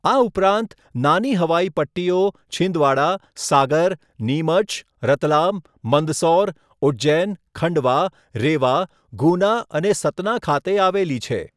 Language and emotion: Gujarati, neutral